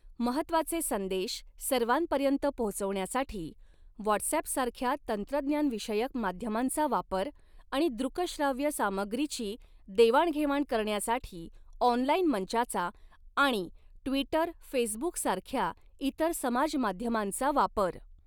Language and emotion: Marathi, neutral